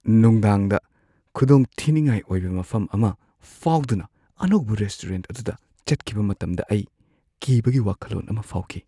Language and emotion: Manipuri, fearful